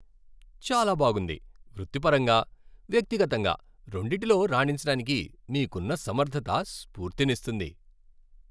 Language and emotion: Telugu, happy